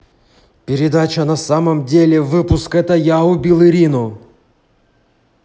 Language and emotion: Russian, angry